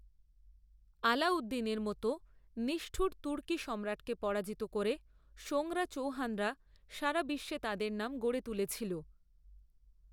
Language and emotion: Bengali, neutral